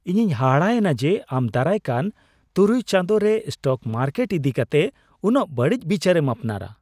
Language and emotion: Santali, surprised